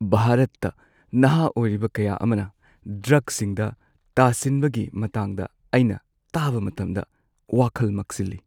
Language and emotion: Manipuri, sad